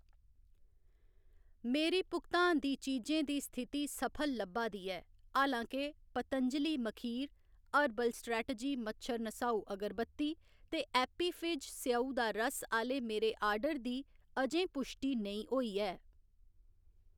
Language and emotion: Dogri, neutral